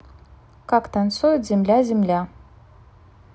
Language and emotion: Russian, neutral